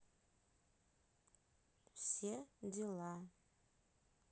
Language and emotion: Russian, neutral